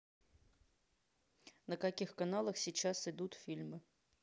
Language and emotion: Russian, neutral